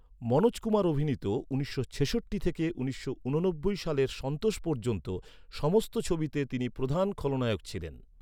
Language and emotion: Bengali, neutral